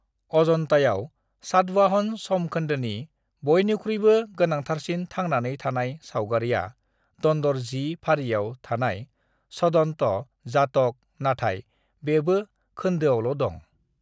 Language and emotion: Bodo, neutral